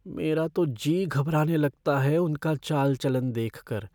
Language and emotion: Hindi, fearful